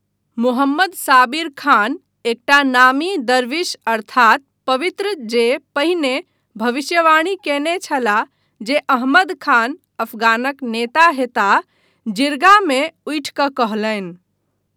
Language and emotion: Maithili, neutral